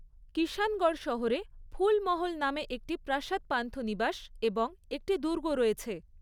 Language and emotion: Bengali, neutral